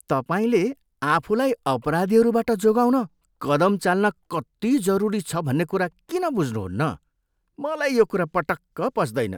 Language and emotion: Nepali, disgusted